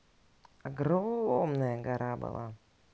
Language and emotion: Russian, neutral